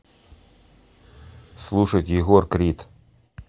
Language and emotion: Russian, neutral